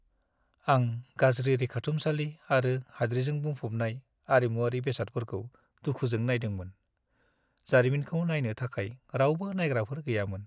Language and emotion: Bodo, sad